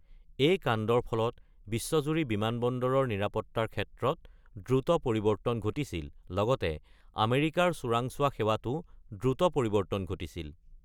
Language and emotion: Assamese, neutral